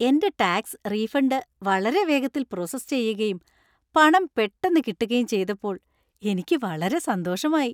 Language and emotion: Malayalam, happy